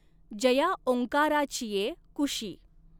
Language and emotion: Marathi, neutral